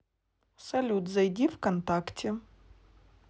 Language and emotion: Russian, neutral